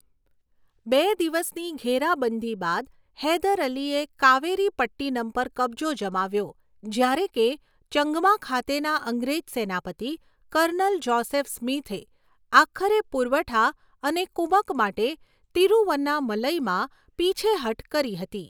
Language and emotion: Gujarati, neutral